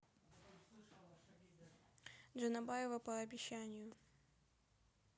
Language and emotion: Russian, neutral